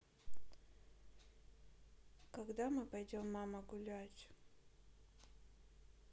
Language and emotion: Russian, sad